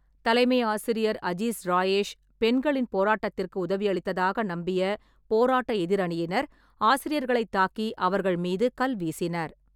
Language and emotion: Tamil, neutral